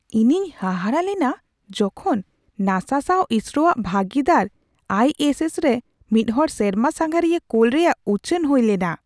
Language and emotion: Santali, surprised